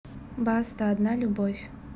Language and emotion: Russian, neutral